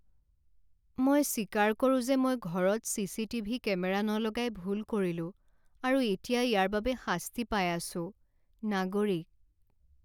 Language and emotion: Assamese, sad